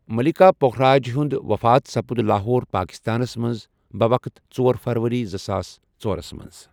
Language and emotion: Kashmiri, neutral